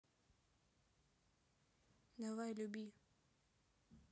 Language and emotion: Russian, neutral